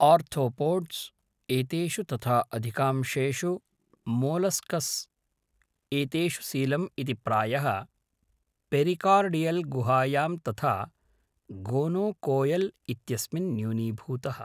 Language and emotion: Sanskrit, neutral